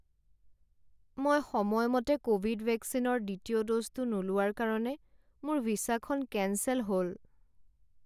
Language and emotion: Assamese, sad